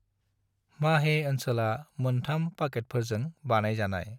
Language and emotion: Bodo, neutral